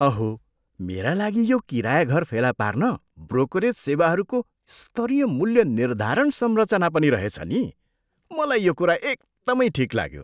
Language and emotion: Nepali, surprised